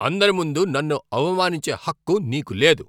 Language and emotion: Telugu, angry